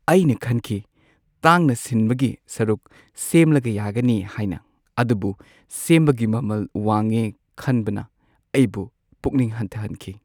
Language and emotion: Manipuri, sad